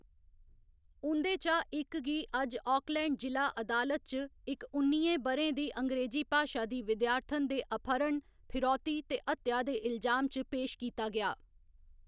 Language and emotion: Dogri, neutral